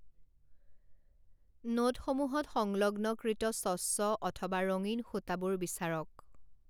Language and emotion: Assamese, neutral